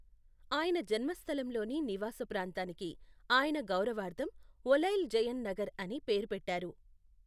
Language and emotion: Telugu, neutral